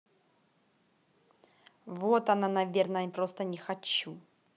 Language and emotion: Russian, angry